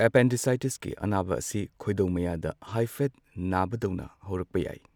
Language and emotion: Manipuri, neutral